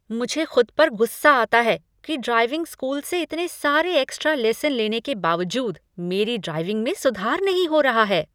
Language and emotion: Hindi, angry